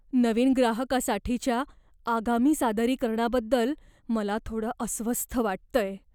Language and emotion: Marathi, fearful